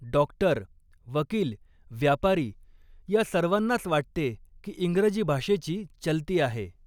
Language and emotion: Marathi, neutral